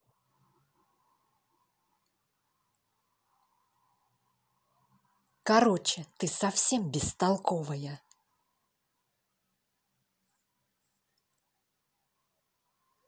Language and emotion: Russian, angry